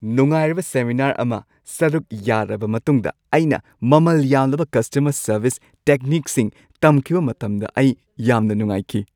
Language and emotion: Manipuri, happy